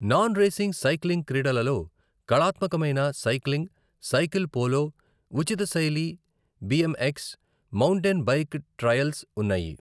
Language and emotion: Telugu, neutral